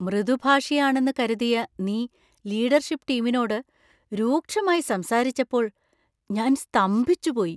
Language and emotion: Malayalam, surprised